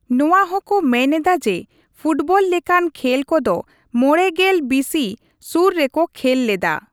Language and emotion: Santali, neutral